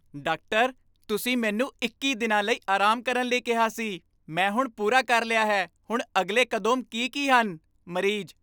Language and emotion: Punjabi, happy